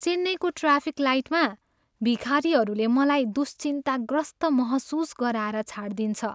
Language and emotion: Nepali, sad